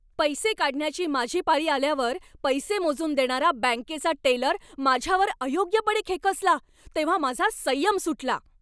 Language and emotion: Marathi, angry